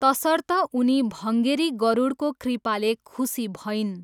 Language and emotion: Nepali, neutral